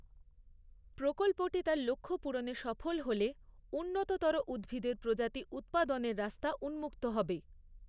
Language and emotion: Bengali, neutral